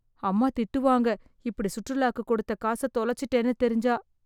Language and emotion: Tamil, fearful